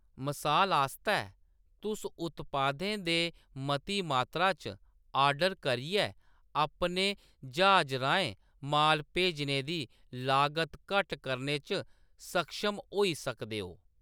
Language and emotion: Dogri, neutral